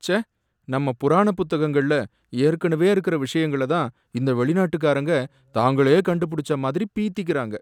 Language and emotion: Tamil, sad